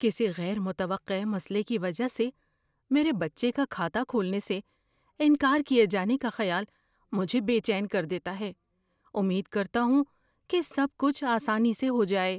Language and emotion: Urdu, fearful